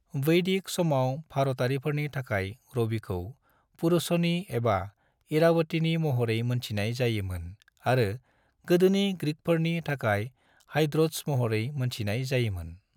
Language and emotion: Bodo, neutral